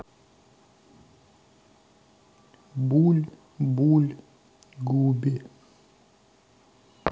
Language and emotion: Russian, neutral